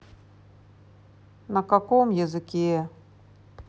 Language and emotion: Russian, sad